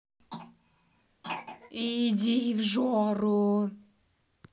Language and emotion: Russian, angry